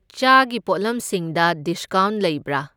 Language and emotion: Manipuri, neutral